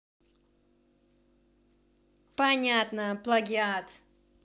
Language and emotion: Russian, angry